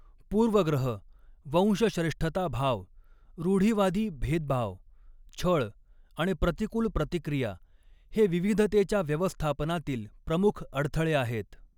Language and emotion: Marathi, neutral